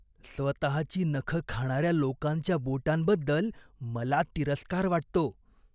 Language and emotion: Marathi, disgusted